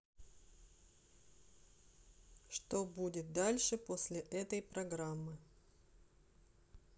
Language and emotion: Russian, neutral